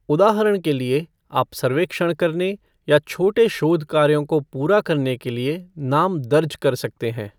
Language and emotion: Hindi, neutral